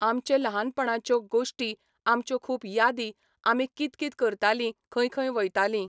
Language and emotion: Goan Konkani, neutral